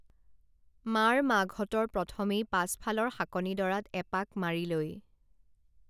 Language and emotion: Assamese, neutral